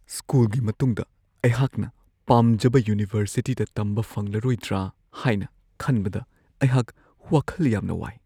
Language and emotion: Manipuri, fearful